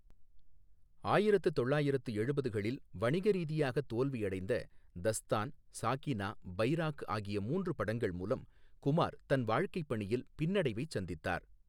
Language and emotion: Tamil, neutral